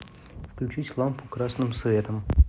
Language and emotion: Russian, neutral